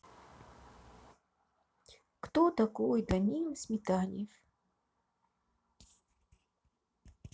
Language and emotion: Russian, neutral